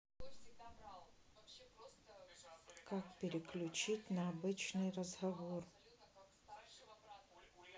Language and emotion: Russian, neutral